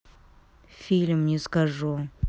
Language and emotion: Russian, neutral